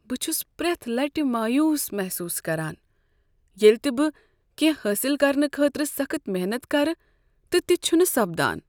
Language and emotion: Kashmiri, sad